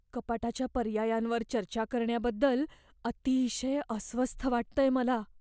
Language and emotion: Marathi, fearful